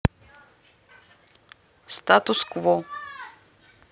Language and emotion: Russian, neutral